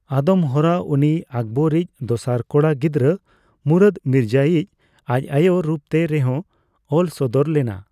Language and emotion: Santali, neutral